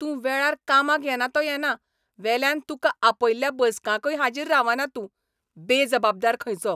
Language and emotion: Goan Konkani, angry